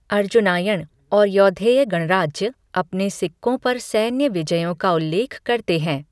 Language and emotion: Hindi, neutral